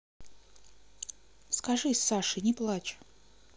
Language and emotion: Russian, neutral